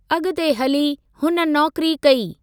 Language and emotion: Sindhi, neutral